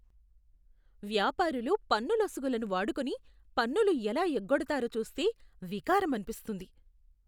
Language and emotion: Telugu, disgusted